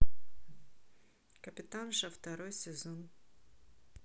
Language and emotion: Russian, neutral